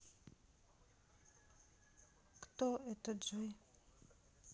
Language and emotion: Russian, sad